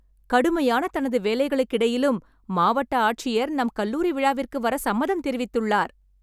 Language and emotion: Tamil, happy